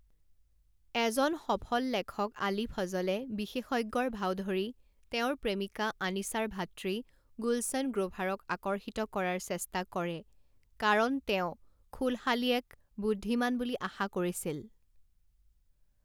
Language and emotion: Assamese, neutral